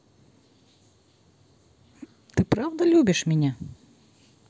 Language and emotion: Russian, neutral